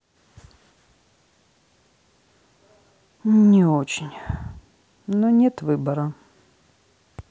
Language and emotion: Russian, sad